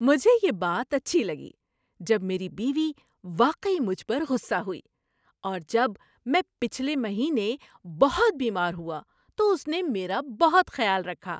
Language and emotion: Urdu, happy